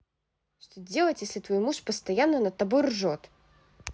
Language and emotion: Russian, angry